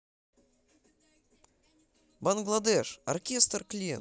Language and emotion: Russian, positive